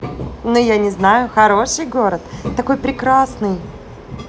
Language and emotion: Russian, positive